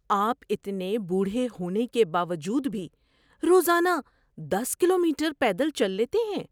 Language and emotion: Urdu, surprised